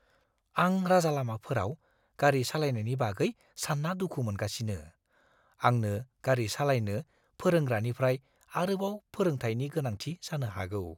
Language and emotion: Bodo, fearful